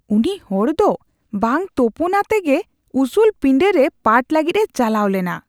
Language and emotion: Santali, disgusted